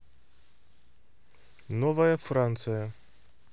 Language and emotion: Russian, neutral